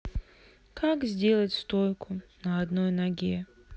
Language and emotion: Russian, sad